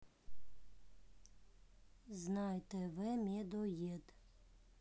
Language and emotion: Russian, neutral